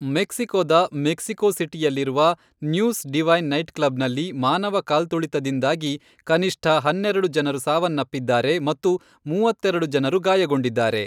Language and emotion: Kannada, neutral